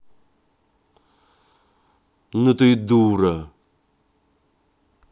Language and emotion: Russian, angry